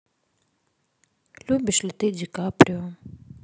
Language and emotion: Russian, sad